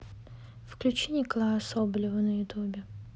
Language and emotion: Russian, neutral